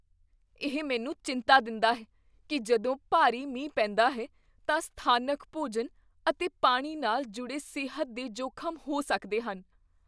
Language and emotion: Punjabi, fearful